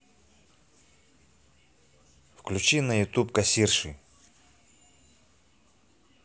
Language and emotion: Russian, neutral